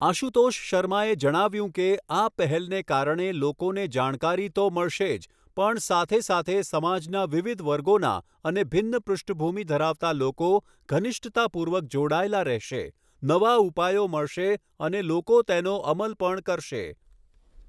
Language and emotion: Gujarati, neutral